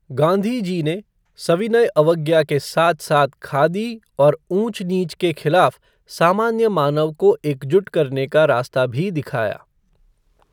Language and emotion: Hindi, neutral